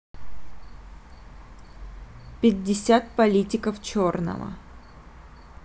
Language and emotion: Russian, neutral